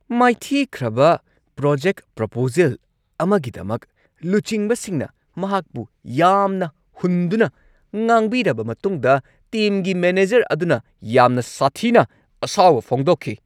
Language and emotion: Manipuri, angry